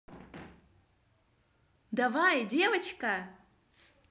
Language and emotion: Russian, positive